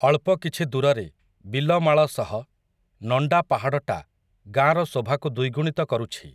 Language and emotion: Odia, neutral